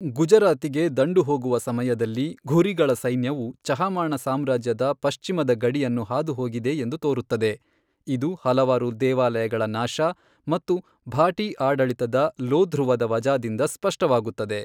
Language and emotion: Kannada, neutral